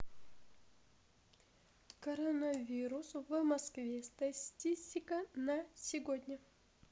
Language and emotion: Russian, neutral